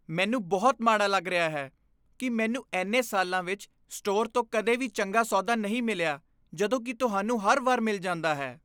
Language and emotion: Punjabi, disgusted